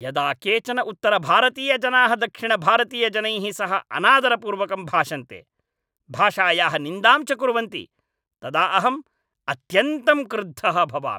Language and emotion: Sanskrit, angry